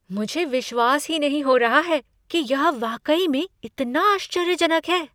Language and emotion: Hindi, surprised